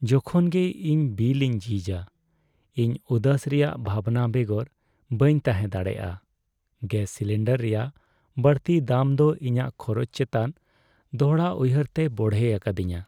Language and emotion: Santali, sad